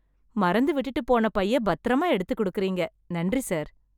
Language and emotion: Tamil, happy